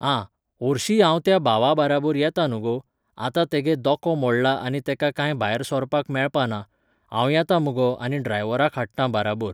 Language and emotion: Goan Konkani, neutral